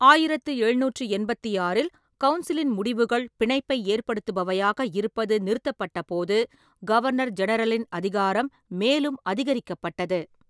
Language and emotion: Tamil, neutral